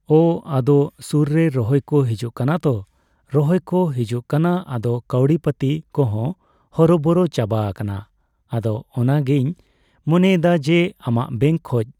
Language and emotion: Santali, neutral